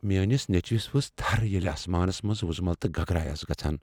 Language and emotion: Kashmiri, fearful